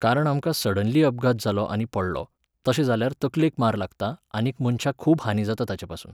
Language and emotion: Goan Konkani, neutral